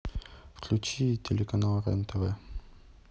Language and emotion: Russian, neutral